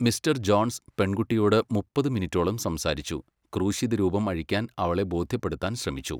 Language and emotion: Malayalam, neutral